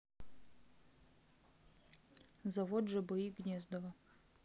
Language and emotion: Russian, neutral